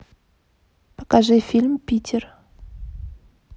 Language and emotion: Russian, neutral